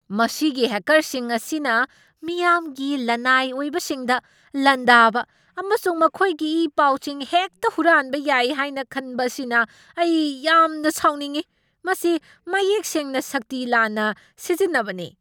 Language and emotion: Manipuri, angry